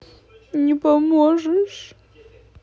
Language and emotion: Russian, sad